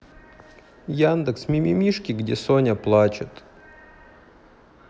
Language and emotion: Russian, sad